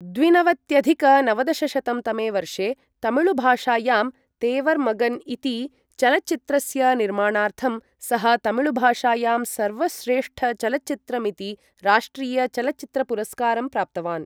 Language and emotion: Sanskrit, neutral